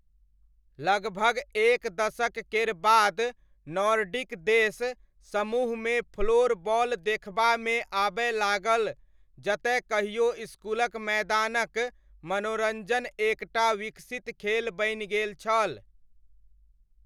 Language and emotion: Maithili, neutral